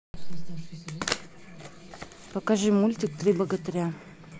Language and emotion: Russian, neutral